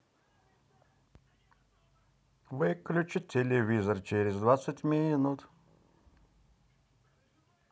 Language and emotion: Russian, positive